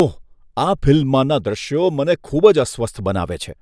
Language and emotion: Gujarati, disgusted